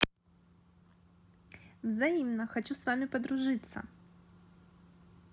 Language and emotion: Russian, neutral